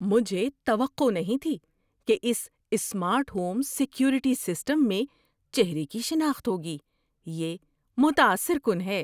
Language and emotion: Urdu, surprised